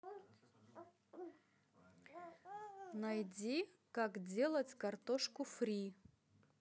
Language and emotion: Russian, neutral